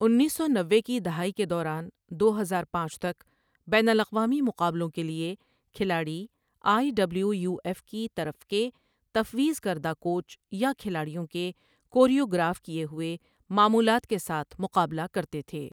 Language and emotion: Urdu, neutral